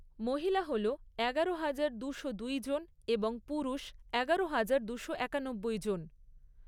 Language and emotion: Bengali, neutral